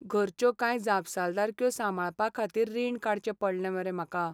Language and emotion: Goan Konkani, sad